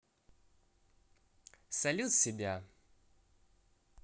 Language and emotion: Russian, positive